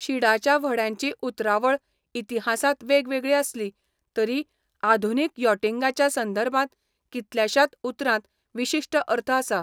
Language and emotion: Goan Konkani, neutral